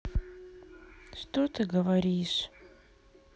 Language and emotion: Russian, sad